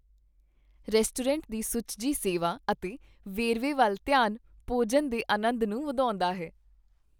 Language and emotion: Punjabi, happy